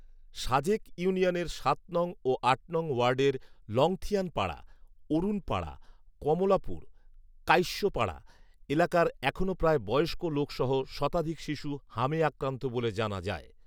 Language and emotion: Bengali, neutral